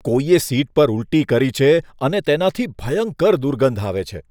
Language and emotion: Gujarati, disgusted